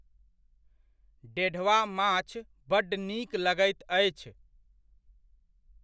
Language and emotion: Maithili, neutral